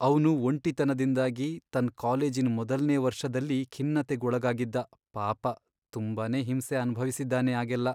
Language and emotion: Kannada, sad